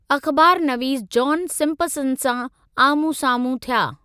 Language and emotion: Sindhi, neutral